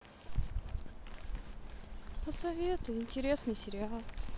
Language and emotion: Russian, sad